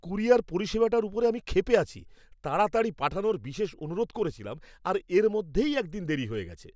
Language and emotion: Bengali, angry